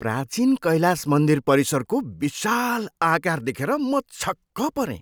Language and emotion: Nepali, surprised